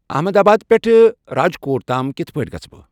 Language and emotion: Kashmiri, neutral